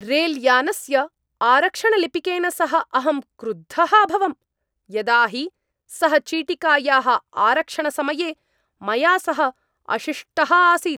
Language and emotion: Sanskrit, angry